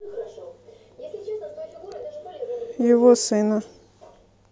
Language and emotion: Russian, neutral